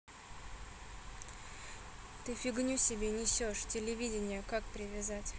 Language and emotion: Russian, neutral